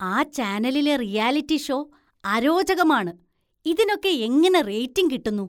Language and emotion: Malayalam, disgusted